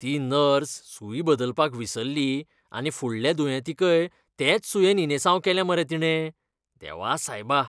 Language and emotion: Goan Konkani, disgusted